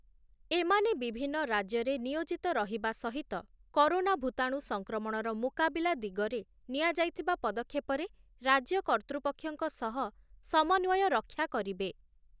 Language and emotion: Odia, neutral